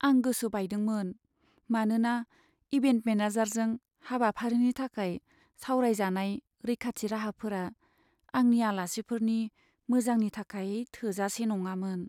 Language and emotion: Bodo, sad